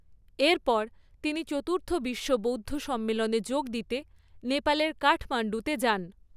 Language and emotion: Bengali, neutral